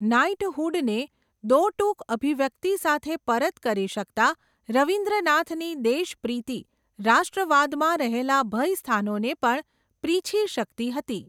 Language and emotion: Gujarati, neutral